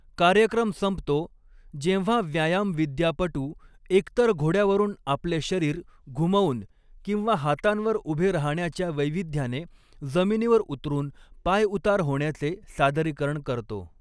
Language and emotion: Marathi, neutral